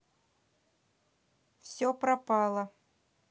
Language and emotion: Russian, neutral